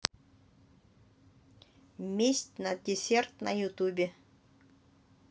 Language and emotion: Russian, neutral